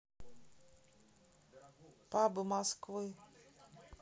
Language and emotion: Russian, neutral